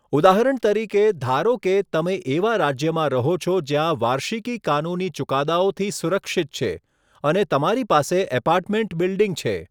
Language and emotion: Gujarati, neutral